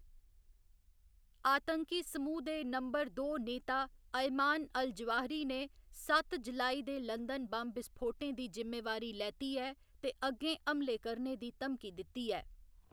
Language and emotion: Dogri, neutral